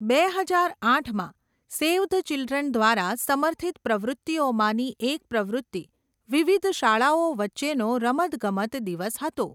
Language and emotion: Gujarati, neutral